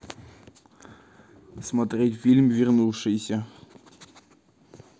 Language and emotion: Russian, neutral